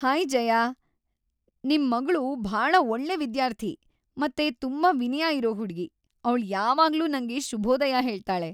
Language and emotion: Kannada, happy